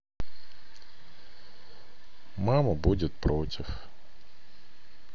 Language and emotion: Russian, sad